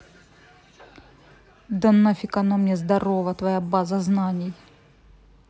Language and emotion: Russian, angry